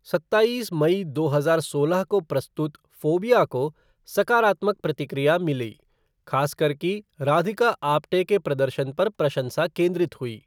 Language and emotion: Hindi, neutral